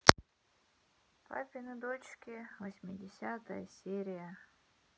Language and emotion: Russian, sad